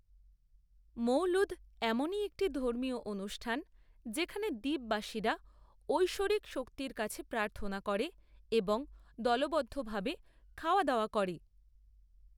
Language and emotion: Bengali, neutral